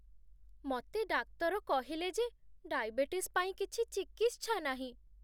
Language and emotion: Odia, sad